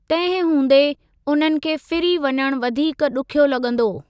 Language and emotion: Sindhi, neutral